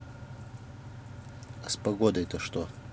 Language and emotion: Russian, neutral